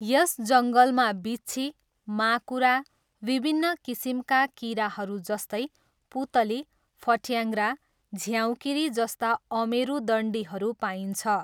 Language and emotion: Nepali, neutral